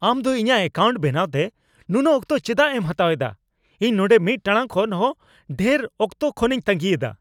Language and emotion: Santali, angry